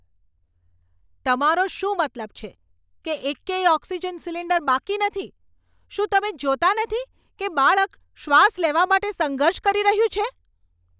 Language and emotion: Gujarati, angry